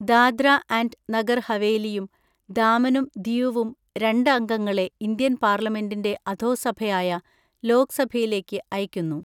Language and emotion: Malayalam, neutral